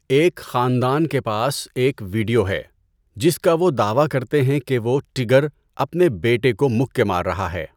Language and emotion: Urdu, neutral